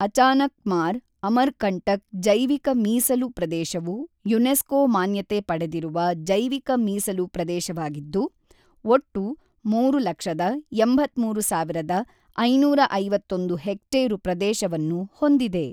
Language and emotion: Kannada, neutral